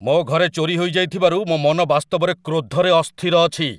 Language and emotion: Odia, angry